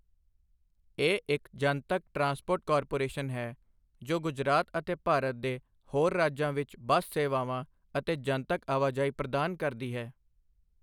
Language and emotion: Punjabi, neutral